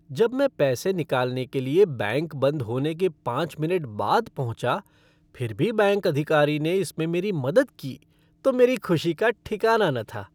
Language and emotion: Hindi, happy